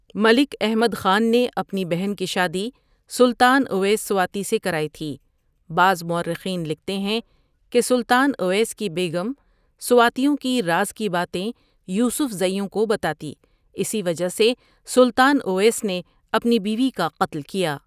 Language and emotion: Urdu, neutral